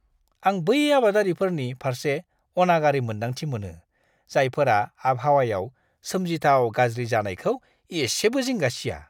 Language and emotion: Bodo, disgusted